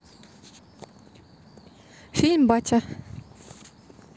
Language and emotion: Russian, neutral